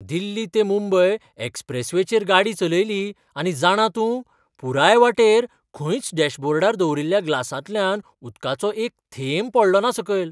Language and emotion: Goan Konkani, surprised